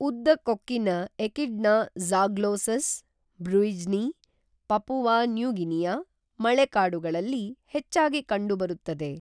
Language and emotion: Kannada, neutral